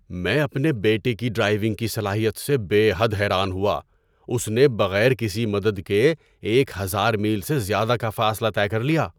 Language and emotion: Urdu, surprised